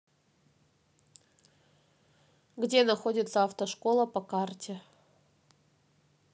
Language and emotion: Russian, neutral